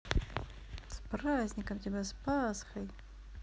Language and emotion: Russian, positive